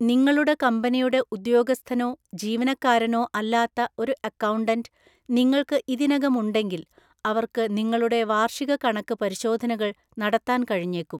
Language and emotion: Malayalam, neutral